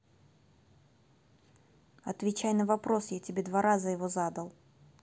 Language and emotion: Russian, neutral